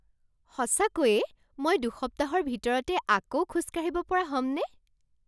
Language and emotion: Assamese, surprised